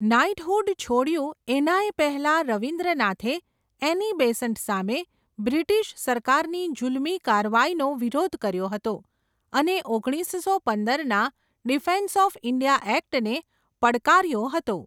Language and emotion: Gujarati, neutral